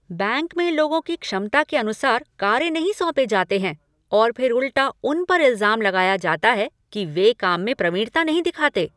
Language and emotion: Hindi, angry